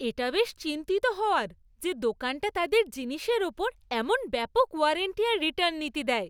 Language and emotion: Bengali, happy